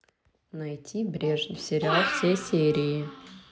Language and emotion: Russian, neutral